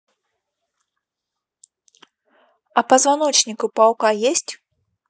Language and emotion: Russian, neutral